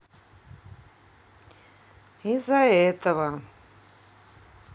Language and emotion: Russian, sad